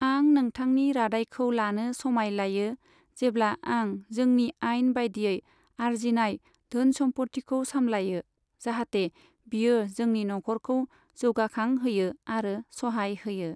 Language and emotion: Bodo, neutral